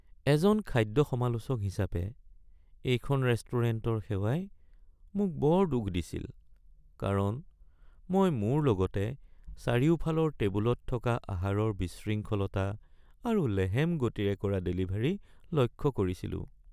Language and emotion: Assamese, sad